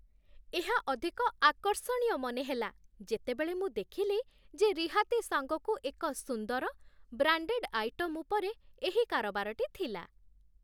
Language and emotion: Odia, happy